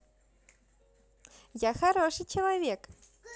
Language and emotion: Russian, positive